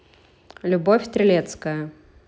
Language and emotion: Russian, neutral